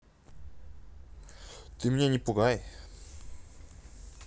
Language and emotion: Russian, neutral